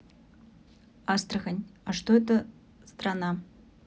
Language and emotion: Russian, neutral